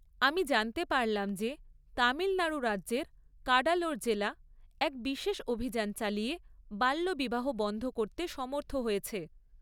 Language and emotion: Bengali, neutral